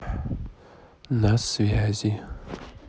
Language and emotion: Russian, neutral